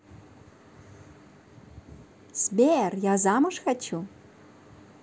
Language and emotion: Russian, positive